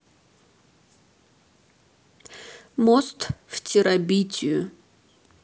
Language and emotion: Russian, neutral